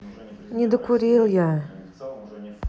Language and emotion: Russian, sad